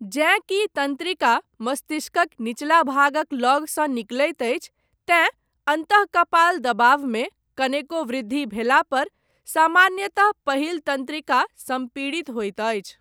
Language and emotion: Maithili, neutral